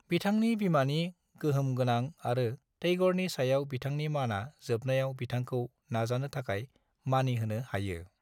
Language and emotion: Bodo, neutral